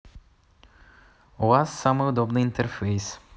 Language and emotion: Russian, positive